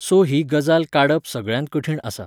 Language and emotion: Goan Konkani, neutral